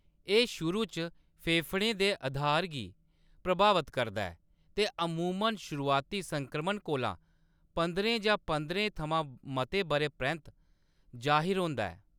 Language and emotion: Dogri, neutral